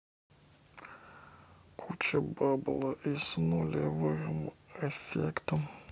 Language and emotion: Russian, sad